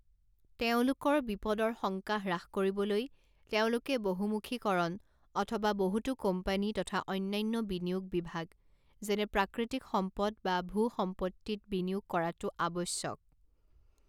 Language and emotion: Assamese, neutral